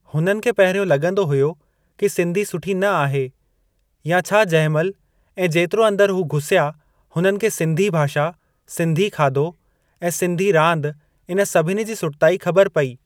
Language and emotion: Sindhi, neutral